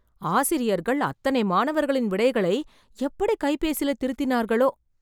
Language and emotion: Tamil, surprised